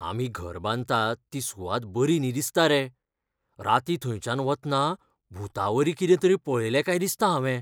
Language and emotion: Goan Konkani, fearful